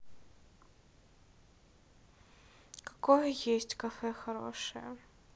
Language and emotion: Russian, neutral